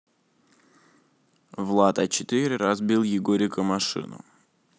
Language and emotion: Russian, neutral